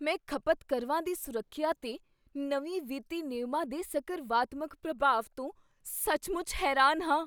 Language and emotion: Punjabi, surprised